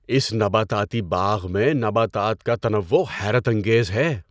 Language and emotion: Urdu, surprised